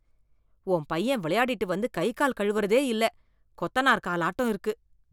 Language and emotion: Tamil, disgusted